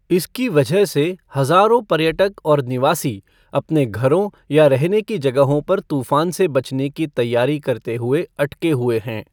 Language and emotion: Hindi, neutral